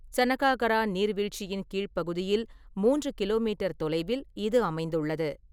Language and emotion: Tamil, neutral